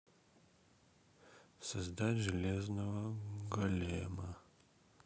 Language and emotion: Russian, sad